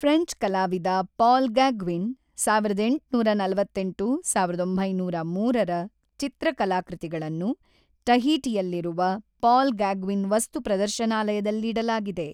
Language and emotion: Kannada, neutral